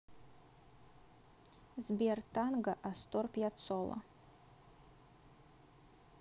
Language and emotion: Russian, neutral